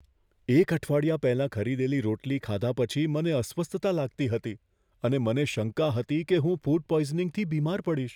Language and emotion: Gujarati, fearful